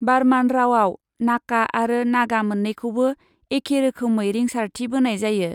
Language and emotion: Bodo, neutral